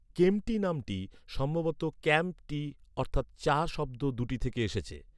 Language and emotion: Bengali, neutral